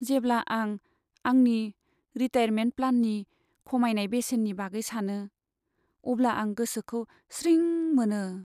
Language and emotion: Bodo, sad